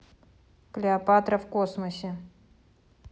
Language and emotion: Russian, neutral